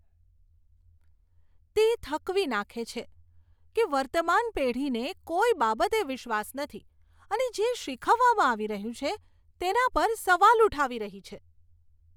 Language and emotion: Gujarati, disgusted